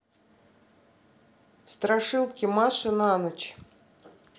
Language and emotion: Russian, neutral